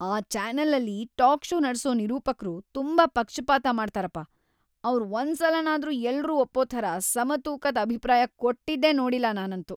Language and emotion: Kannada, disgusted